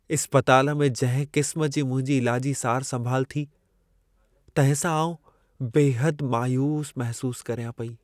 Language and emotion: Sindhi, sad